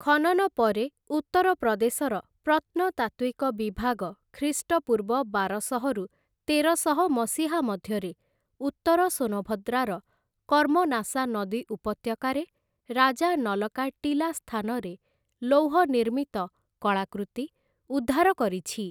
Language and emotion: Odia, neutral